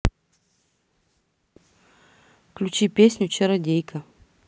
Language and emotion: Russian, neutral